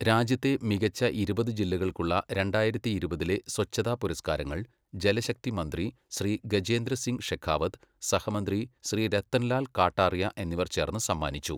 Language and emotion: Malayalam, neutral